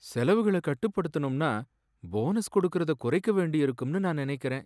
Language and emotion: Tamil, sad